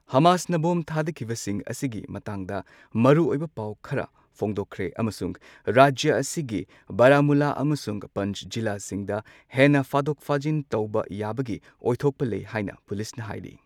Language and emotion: Manipuri, neutral